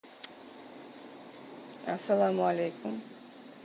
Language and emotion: Russian, neutral